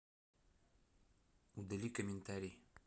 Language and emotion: Russian, neutral